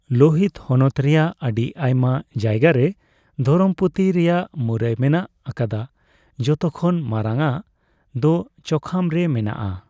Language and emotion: Santali, neutral